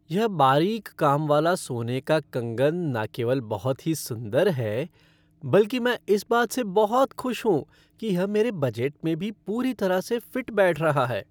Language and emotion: Hindi, happy